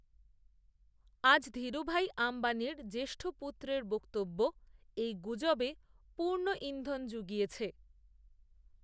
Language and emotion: Bengali, neutral